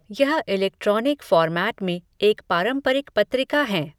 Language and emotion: Hindi, neutral